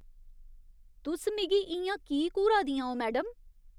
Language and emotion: Dogri, disgusted